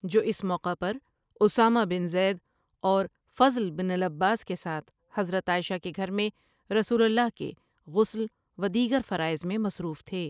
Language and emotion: Urdu, neutral